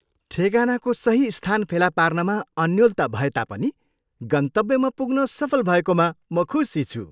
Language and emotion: Nepali, happy